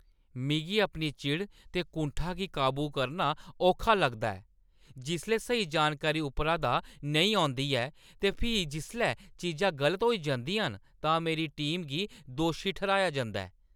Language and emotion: Dogri, angry